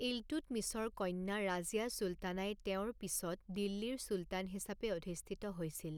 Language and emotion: Assamese, neutral